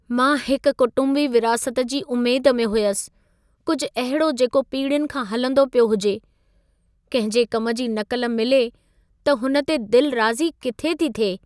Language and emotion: Sindhi, sad